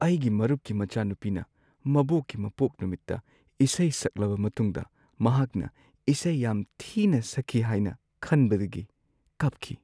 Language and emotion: Manipuri, sad